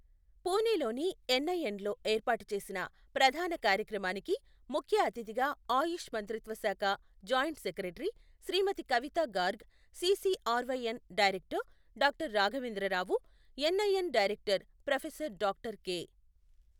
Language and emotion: Telugu, neutral